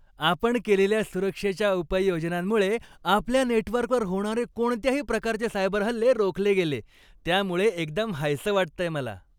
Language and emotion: Marathi, happy